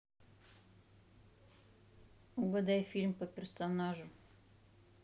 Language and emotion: Russian, neutral